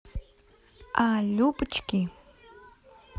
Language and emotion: Russian, positive